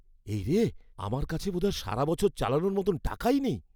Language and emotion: Bengali, fearful